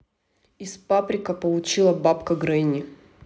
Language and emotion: Russian, neutral